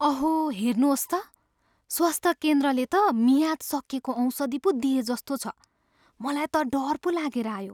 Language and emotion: Nepali, fearful